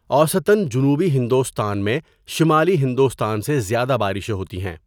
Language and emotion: Urdu, neutral